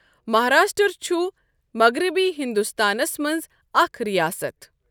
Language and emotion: Kashmiri, neutral